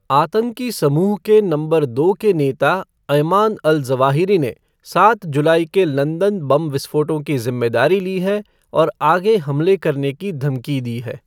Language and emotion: Hindi, neutral